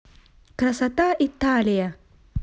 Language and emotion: Russian, positive